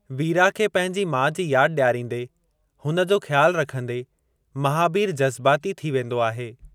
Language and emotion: Sindhi, neutral